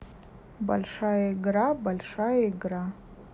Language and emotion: Russian, neutral